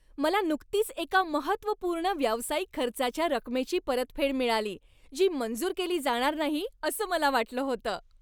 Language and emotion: Marathi, happy